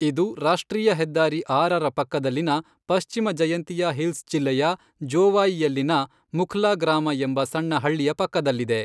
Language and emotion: Kannada, neutral